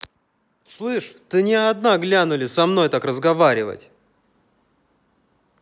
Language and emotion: Russian, angry